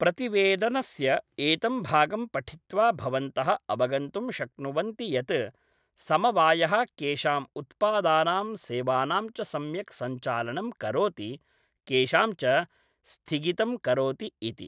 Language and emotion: Sanskrit, neutral